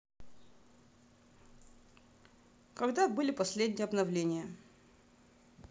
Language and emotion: Russian, neutral